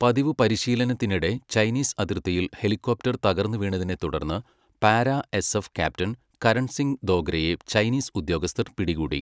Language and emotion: Malayalam, neutral